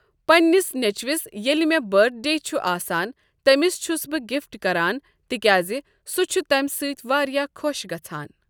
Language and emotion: Kashmiri, neutral